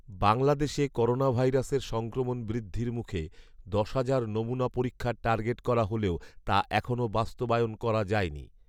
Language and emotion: Bengali, neutral